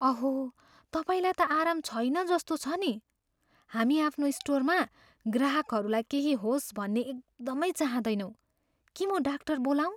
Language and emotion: Nepali, fearful